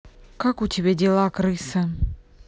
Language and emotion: Russian, angry